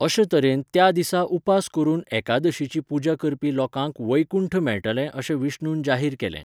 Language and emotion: Goan Konkani, neutral